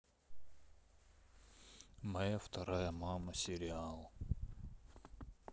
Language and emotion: Russian, sad